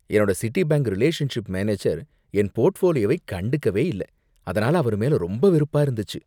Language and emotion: Tamil, disgusted